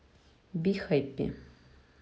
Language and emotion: Russian, neutral